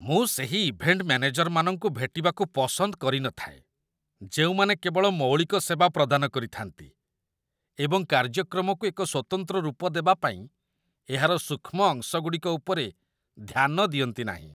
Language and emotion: Odia, disgusted